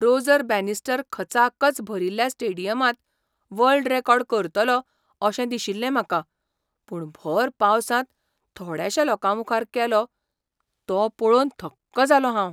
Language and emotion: Goan Konkani, surprised